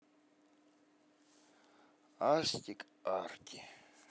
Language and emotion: Russian, sad